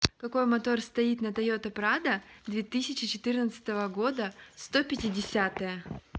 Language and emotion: Russian, neutral